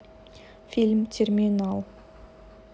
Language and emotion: Russian, neutral